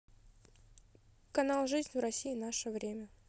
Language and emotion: Russian, neutral